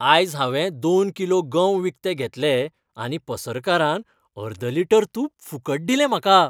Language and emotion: Goan Konkani, happy